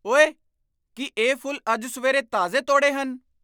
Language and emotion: Punjabi, surprised